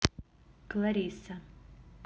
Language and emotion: Russian, neutral